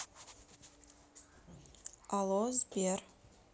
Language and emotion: Russian, neutral